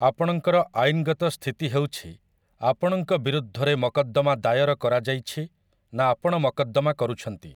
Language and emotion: Odia, neutral